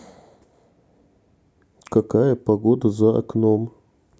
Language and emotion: Russian, neutral